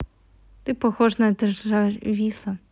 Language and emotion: Russian, neutral